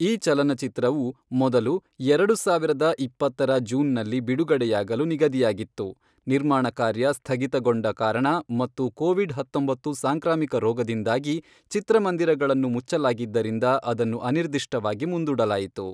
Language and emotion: Kannada, neutral